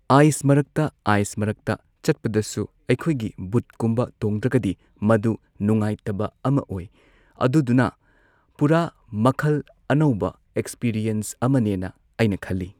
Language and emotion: Manipuri, neutral